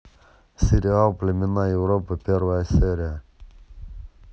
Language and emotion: Russian, neutral